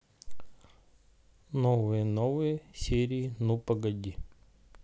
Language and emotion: Russian, neutral